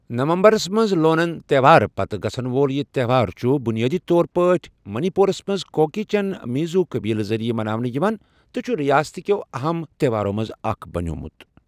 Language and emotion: Kashmiri, neutral